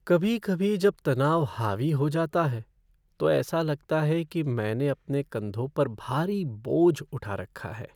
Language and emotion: Hindi, sad